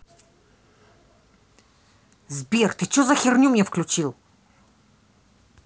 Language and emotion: Russian, angry